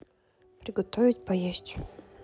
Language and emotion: Russian, neutral